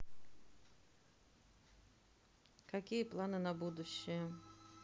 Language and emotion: Russian, neutral